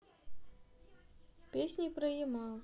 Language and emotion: Russian, neutral